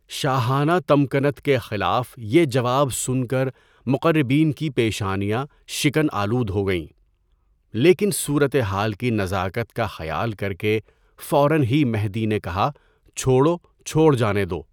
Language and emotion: Urdu, neutral